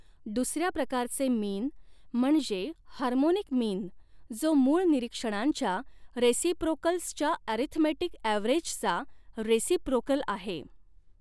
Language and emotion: Marathi, neutral